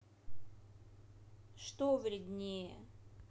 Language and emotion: Russian, neutral